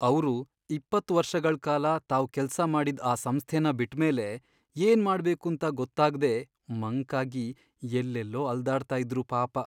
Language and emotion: Kannada, sad